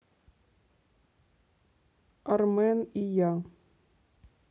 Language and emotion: Russian, neutral